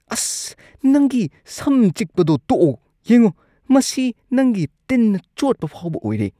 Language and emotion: Manipuri, disgusted